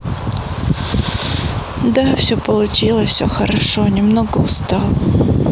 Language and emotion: Russian, sad